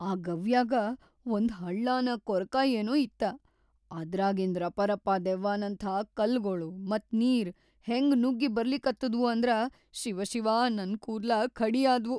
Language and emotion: Kannada, fearful